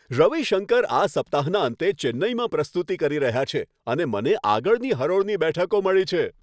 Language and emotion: Gujarati, happy